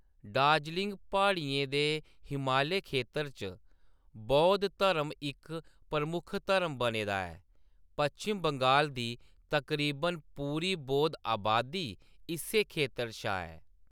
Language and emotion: Dogri, neutral